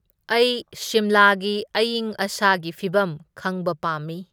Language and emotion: Manipuri, neutral